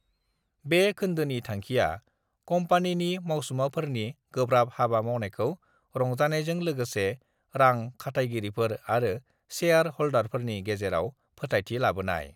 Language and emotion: Bodo, neutral